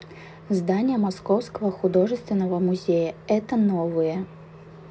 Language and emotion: Russian, neutral